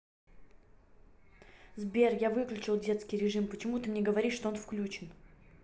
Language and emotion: Russian, angry